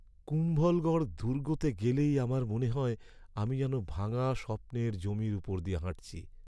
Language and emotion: Bengali, sad